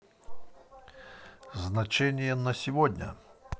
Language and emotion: Russian, positive